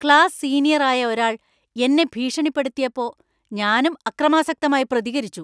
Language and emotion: Malayalam, angry